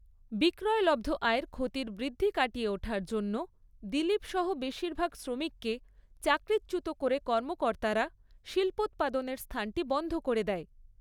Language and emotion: Bengali, neutral